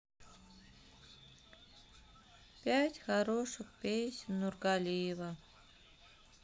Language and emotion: Russian, sad